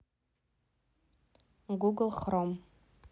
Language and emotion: Russian, neutral